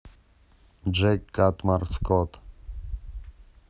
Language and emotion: Russian, neutral